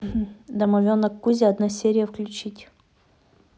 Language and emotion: Russian, neutral